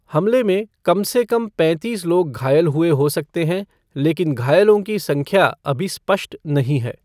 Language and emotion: Hindi, neutral